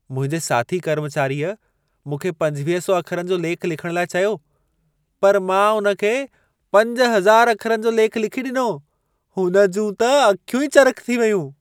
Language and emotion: Sindhi, surprised